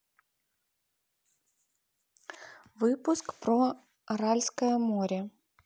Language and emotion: Russian, neutral